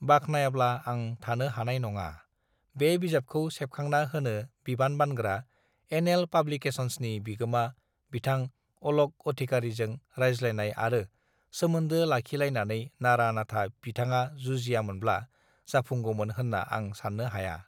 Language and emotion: Bodo, neutral